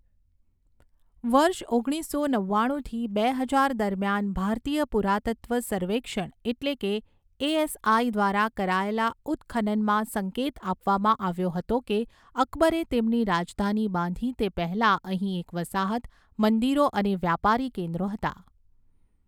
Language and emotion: Gujarati, neutral